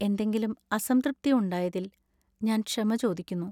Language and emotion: Malayalam, sad